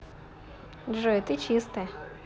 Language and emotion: Russian, positive